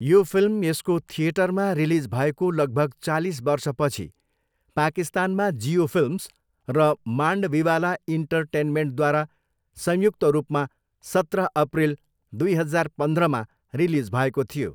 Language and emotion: Nepali, neutral